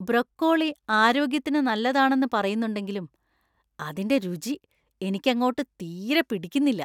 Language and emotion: Malayalam, disgusted